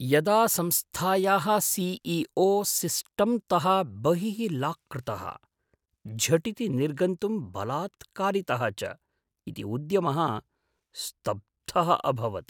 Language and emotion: Sanskrit, surprised